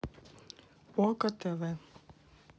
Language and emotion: Russian, neutral